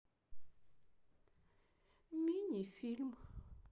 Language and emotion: Russian, sad